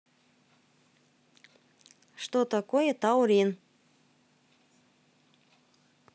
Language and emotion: Russian, neutral